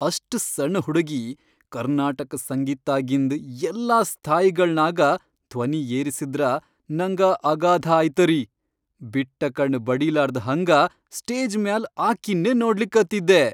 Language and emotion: Kannada, happy